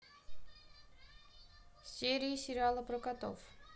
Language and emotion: Russian, neutral